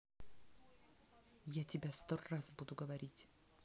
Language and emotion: Russian, angry